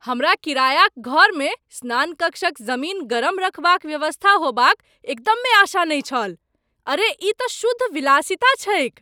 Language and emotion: Maithili, surprised